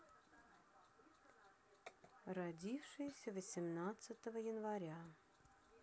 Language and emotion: Russian, neutral